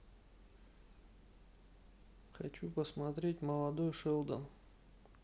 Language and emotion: Russian, neutral